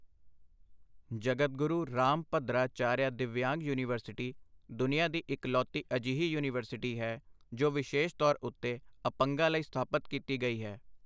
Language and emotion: Punjabi, neutral